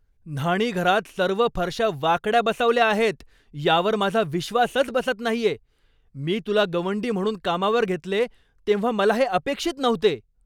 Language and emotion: Marathi, angry